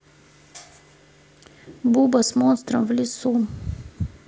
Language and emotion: Russian, neutral